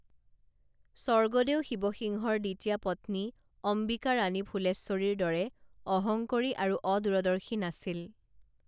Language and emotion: Assamese, neutral